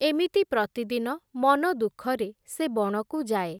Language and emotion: Odia, neutral